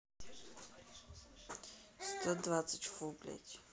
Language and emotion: Russian, neutral